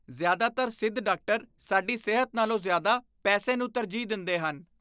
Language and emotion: Punjabi, disgusted